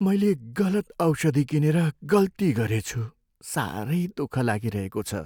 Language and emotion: Nepali, sad